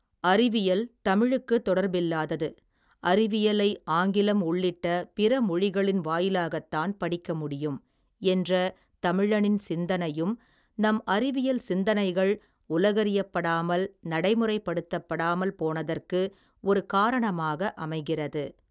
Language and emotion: Tamil, neutral